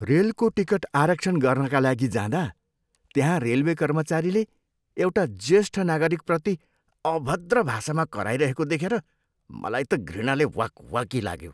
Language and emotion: Nepali, disgusted